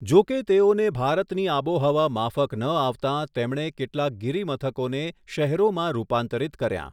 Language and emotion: Gujarati, neutral